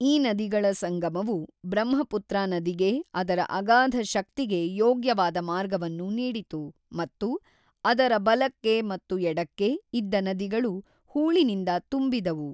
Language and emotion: Kannada, neutral